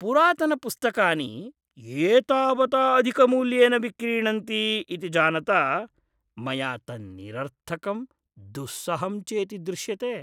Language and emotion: Sanskrit, disgusted